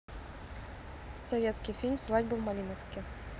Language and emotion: Russian, neutral